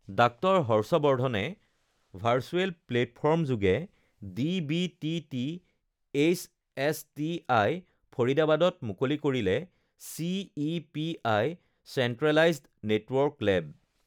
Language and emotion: Assamese, neutral